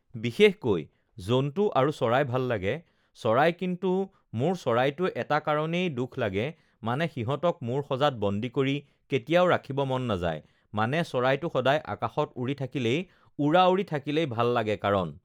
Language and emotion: Assamese, neutral